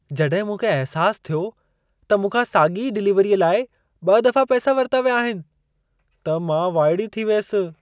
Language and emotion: Sindhi, surprised